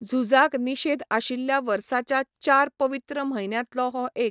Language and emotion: Goan Konkani, neutral